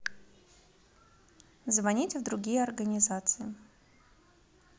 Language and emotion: Russian, positive